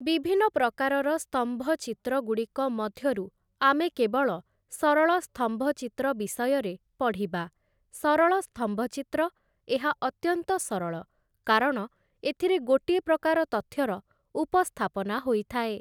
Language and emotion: Odia, neutral